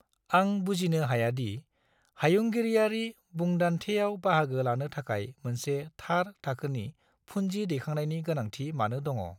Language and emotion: Bodo, neutral